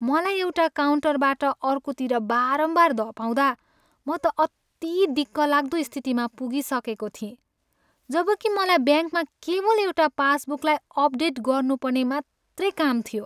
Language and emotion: Nepali, sad